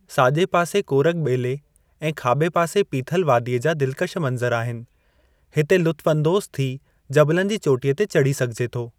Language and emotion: Sindhi, neutral